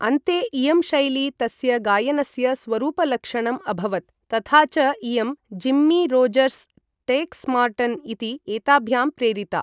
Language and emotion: Sanskrit, neutral